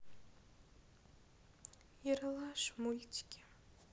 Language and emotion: Russian, sad